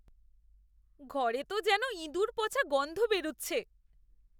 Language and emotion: Bengali, disgusted